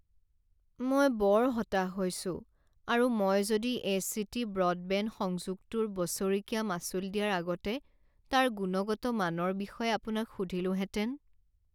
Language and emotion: Assamese, sad